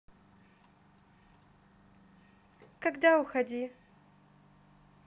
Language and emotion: Russian, neutral